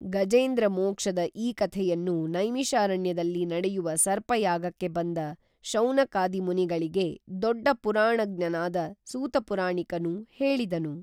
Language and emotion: Kannada, neutral